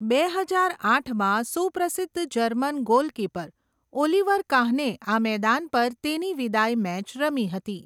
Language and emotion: Gujarati, neutral